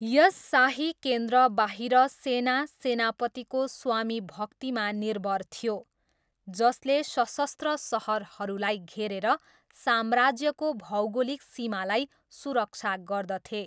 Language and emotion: Nepali, neutral